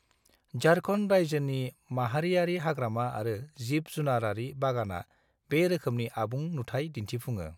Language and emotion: Bodo, neutral